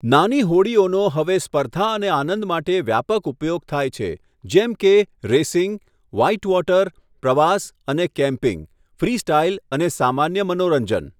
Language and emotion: Gujarati, neutral